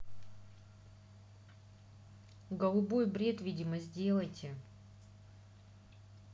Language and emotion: Russian, neutral